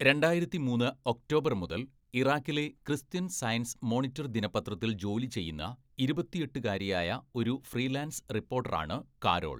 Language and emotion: Malayalam, neutral